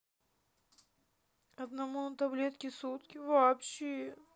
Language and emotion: Russian, sad